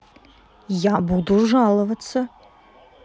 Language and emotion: Russian, neutral